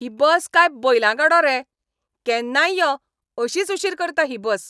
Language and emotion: Goan Konkani, angry